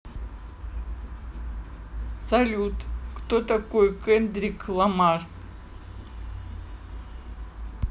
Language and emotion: Russian, neutral